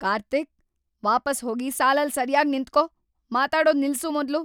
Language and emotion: Kannada, angry